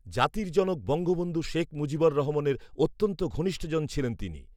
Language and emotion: Bengali, neutral